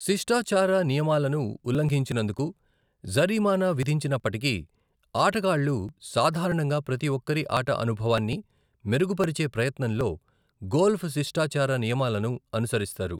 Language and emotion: Telugu, neutral